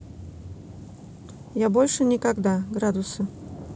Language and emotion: Russian, neutral